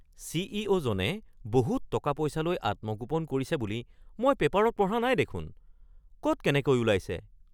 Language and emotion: Assamese, surprised